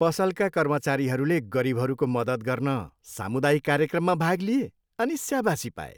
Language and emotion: Nepali, happy